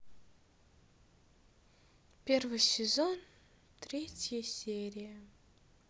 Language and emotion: Russian, sad